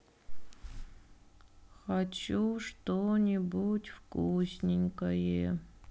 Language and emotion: Russian, sad